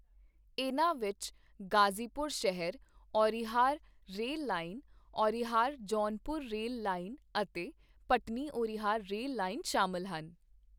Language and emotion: Punjabi, neutral